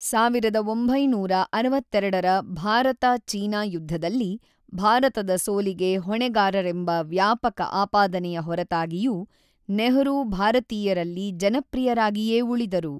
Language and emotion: Kannada, neutral